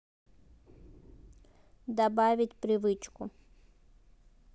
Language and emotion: Russian, neutral